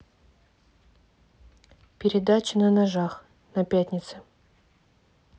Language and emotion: Russian, neutral